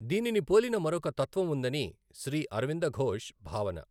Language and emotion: Telugu, neutral